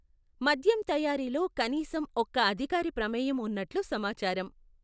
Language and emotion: Telugu, neutral